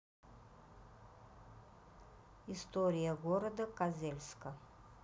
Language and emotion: Russian, neutral